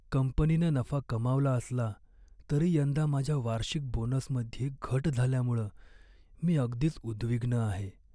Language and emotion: Marathi, sad